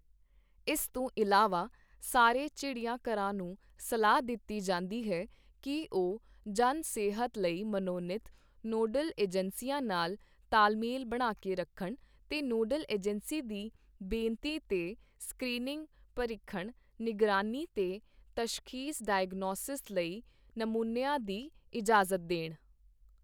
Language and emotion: Punjabi, neutral